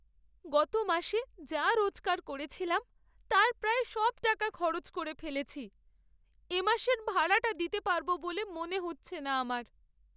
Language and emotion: Bengali, sad